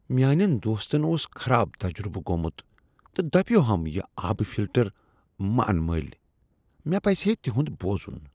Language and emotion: Kashmiri, disgusted